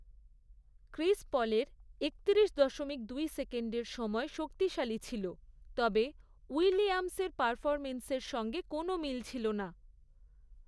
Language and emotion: Bengali, neutral